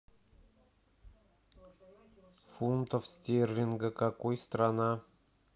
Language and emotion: Russian, neutral